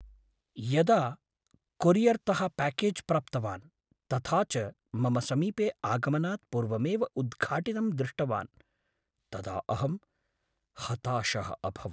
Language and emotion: Sanskrit, sad